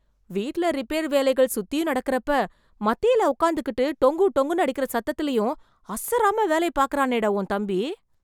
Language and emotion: Tamil, surprised